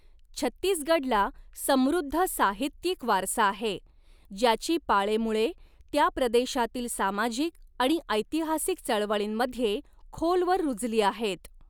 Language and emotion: Marathi, neutral